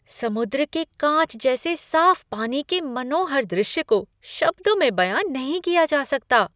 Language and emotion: Hindi, surprised